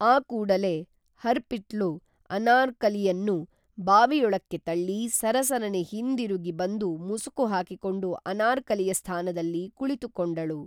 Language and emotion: Kannada, neutral